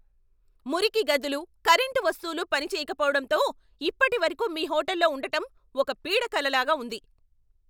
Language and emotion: Telugu, angry